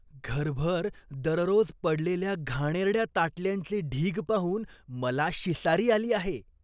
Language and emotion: Marathi, disgusted